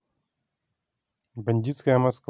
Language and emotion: Russian, neutral